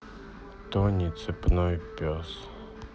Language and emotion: Russian, sad